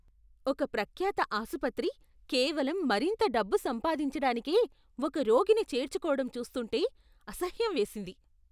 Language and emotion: Telugu, disgusted